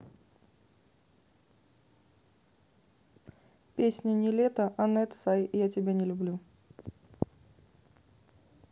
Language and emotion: Russian, neutral